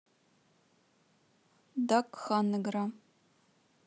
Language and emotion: Russian, neutral